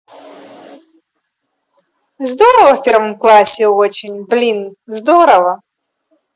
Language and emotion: Russian, positive